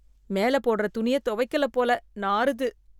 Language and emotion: Tamil, disgusted